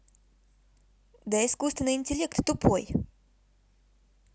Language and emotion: Russian, neutral